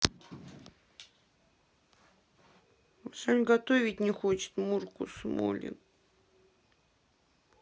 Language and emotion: Russian, sad